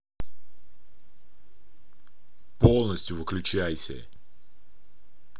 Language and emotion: Russian, angry